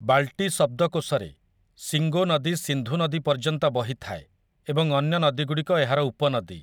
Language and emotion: Odia, neutral